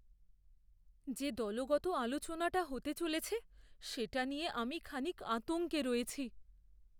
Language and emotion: Bengali, fearful